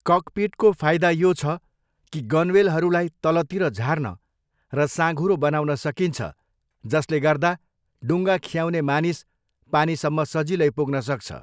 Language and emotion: Nepali, neutral